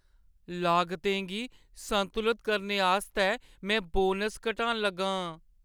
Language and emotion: Dogri, sad